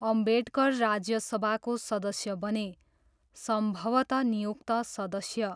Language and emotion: Nepali, neutral